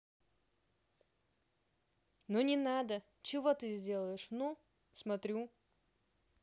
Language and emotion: Russian, angry